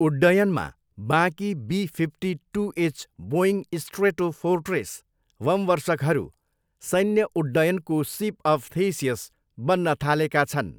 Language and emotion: Nepali, neutral